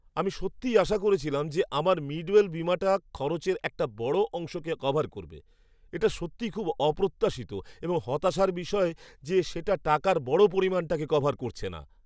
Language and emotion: Bengali, surprised